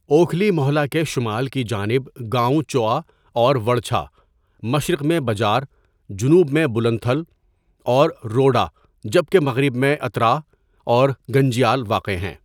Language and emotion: Urdu, neutral